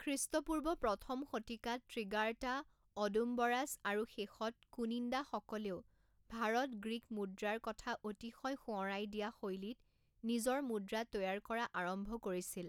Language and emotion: Assamese, neutral